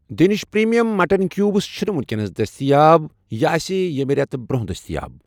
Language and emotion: Kashmiri, neutral